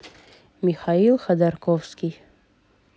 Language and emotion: Russian, neutral